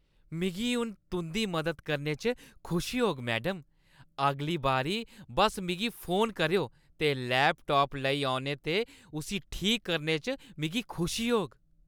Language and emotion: Dogri, happy